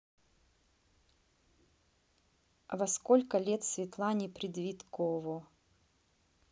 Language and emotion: Russian, neutral